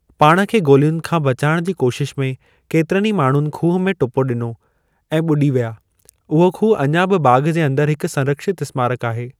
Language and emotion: Sindhi, neutral